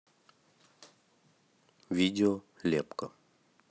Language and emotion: Russian, neutral